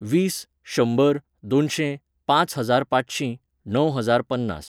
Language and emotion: Goan Konkani, neutral